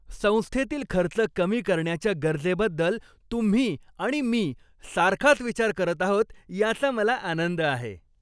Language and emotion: Marathi, happy